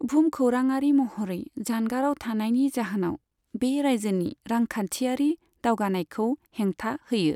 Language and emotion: Bodo, neutral